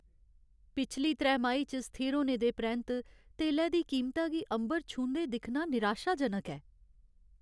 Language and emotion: Dogri, sad